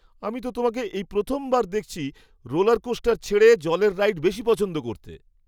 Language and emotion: Bengali, surprised